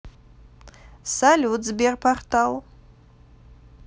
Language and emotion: Russian, positive